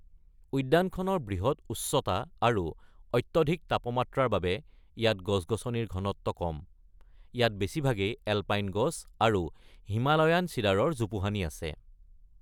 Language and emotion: Assamese, neutral